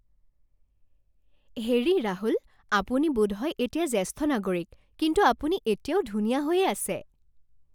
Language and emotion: Assamese, happy